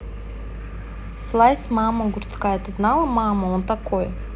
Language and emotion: Russian, neutral